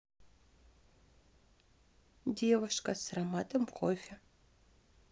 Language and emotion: Russian, neutral